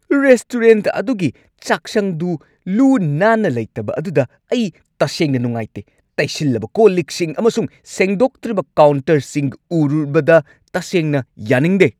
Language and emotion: Manipuri, angry